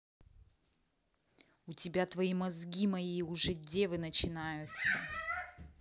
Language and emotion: Russian, angry